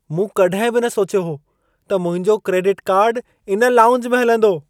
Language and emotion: Sindhi, surprised